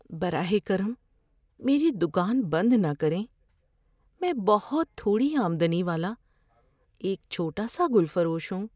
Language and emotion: Urdu, fearful